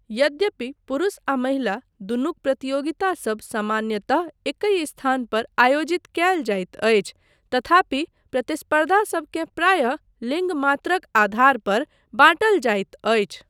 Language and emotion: Maithili, neutral